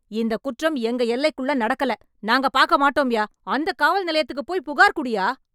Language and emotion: Tamil, angry